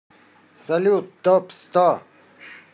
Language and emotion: Russian, positive